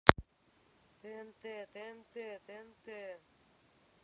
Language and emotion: Russian, neutral